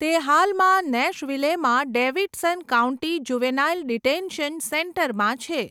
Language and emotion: Gujarati, neutral